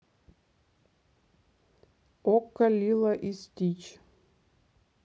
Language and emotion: Russian, neutral